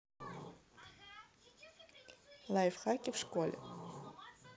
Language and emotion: Russian, neutral